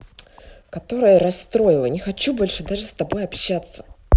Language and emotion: Russian, angry